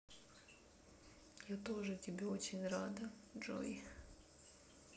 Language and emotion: Russian, sad